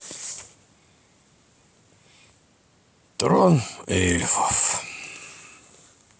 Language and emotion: Russian, sad